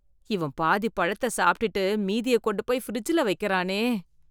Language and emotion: Tamil, disgusted